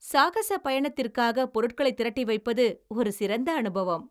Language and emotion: Tamil, happy